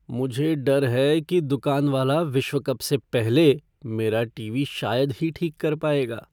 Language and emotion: Hindi, fearful